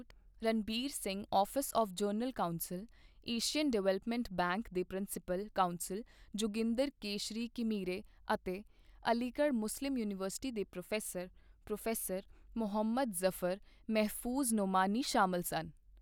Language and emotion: Punjabi, neutral